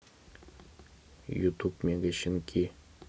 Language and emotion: Russian, neutral